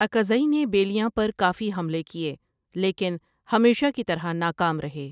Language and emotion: Urdu, neutral